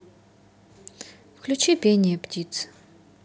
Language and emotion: Russian, neutral